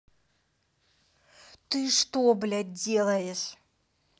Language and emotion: Russian, angry